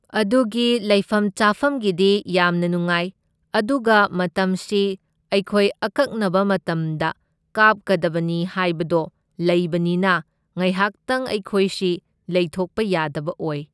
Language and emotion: Manipuri, neutral